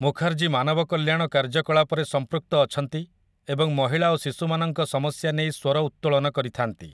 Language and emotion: Odia, neutral